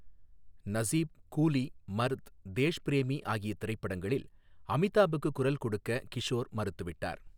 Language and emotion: Tamil, neutral